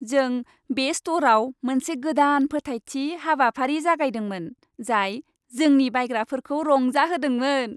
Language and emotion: Bodo, happy